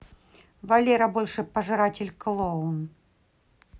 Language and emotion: Russian, angry